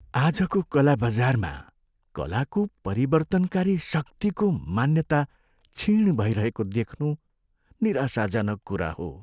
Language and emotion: Nepali, sad